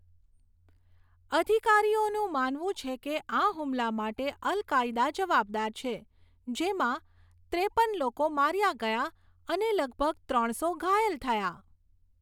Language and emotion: Gujarati, neutral